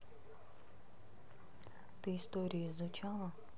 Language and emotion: Russian, neutral